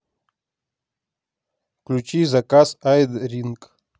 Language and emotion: Russian, neutral